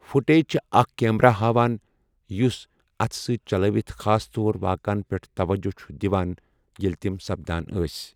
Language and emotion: Kashmiri, neutral